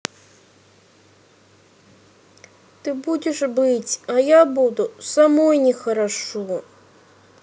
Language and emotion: Russian, sad